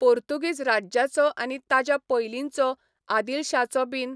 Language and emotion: Goan Konkani, neutral